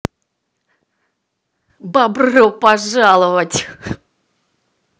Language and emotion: Russian, positive